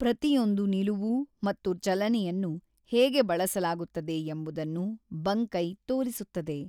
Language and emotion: Kannada, neutral